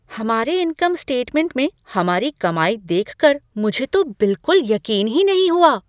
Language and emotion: Hindi, surprised